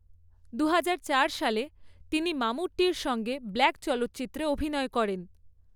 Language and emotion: Bengali, neutral